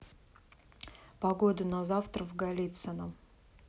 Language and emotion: Russian, neutral